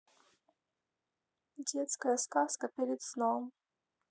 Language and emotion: Russian, neutral